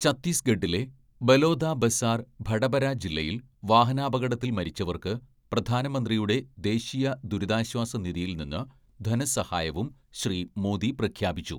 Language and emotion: Malayalam, neutral